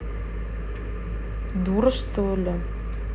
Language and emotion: Russian, angry